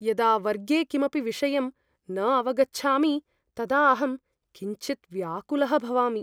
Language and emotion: Sanskrit, fearful